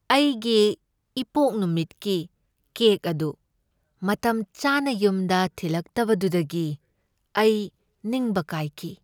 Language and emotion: Manipuri, sad